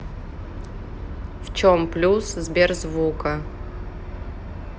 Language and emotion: Russian, neutral